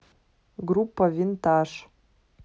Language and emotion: Russian, neutral